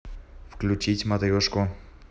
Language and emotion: Russian, neutral